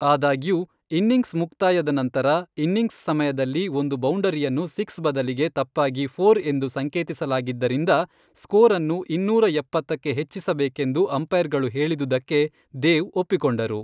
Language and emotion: Kannada, neutral